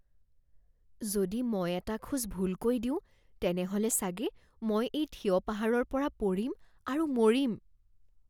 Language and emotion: Assamese, fearful